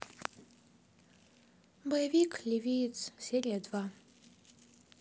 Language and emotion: Russian, sad